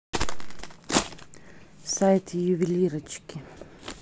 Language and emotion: Russian, neutral